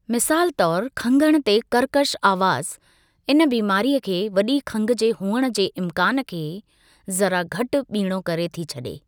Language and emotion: Sindhi, neutral